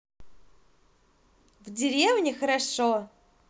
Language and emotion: Russian, positive